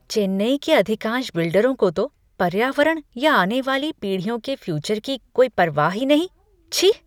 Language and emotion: Hindi, disgusted